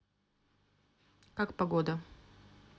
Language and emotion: Russian, neutral